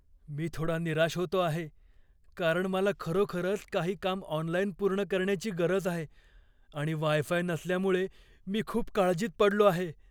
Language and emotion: Marathi, fearful